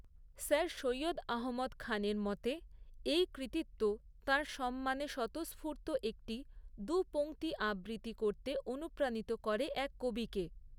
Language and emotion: Bengali, neutral